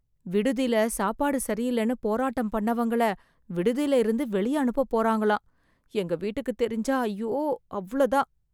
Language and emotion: Tamil, fearful